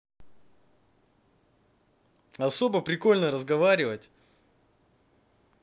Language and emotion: Russian, positive